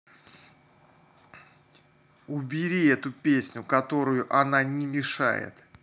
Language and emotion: Russian, angry